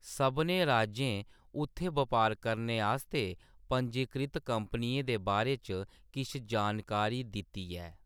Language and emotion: Dogri, neutral